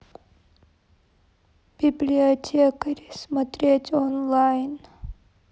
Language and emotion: Russian, sad